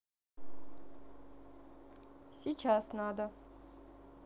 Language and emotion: Russian, neutral